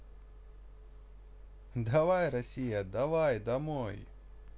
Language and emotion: Russian, positive